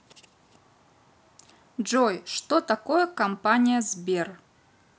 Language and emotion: Russian, neutral